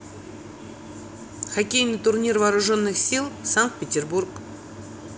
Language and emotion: Russian, neutral